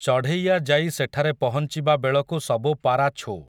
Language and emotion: Odia, neutral